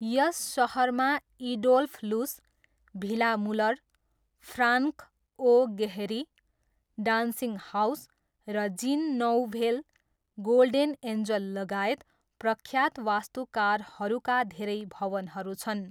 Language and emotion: Nepali, neutral